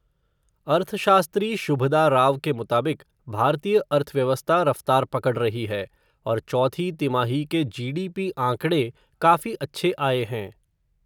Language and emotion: Hindi, neutral